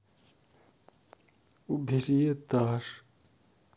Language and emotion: Russian, sad